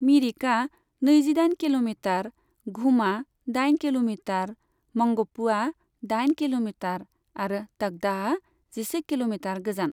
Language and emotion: Bodo, neutral